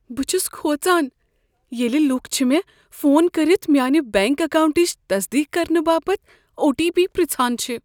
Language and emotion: Kashmiri, fearful